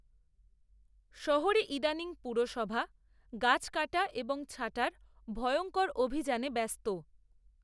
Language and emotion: Bengali, neutral